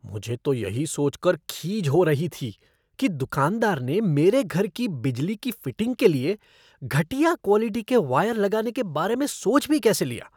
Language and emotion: Hindi, disgusted